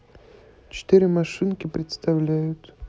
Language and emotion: Russian, neutral